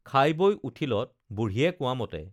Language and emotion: Assamese, neutral